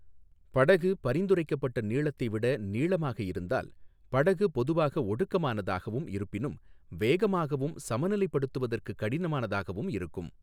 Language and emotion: Tamil, neutral